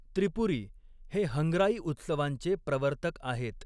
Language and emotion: Marathi, neutral